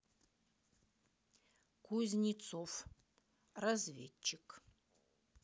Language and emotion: Russian, neutral